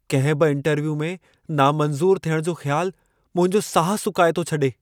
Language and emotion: Sindhi, fearful